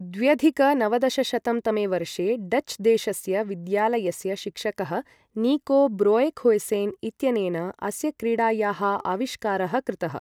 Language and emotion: Sanskrit, neutral